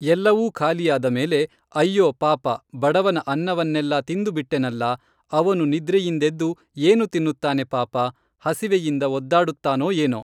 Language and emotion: Kannada, neutral